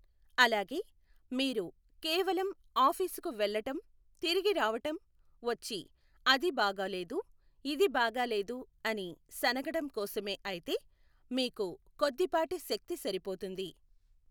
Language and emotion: Telugu, neutral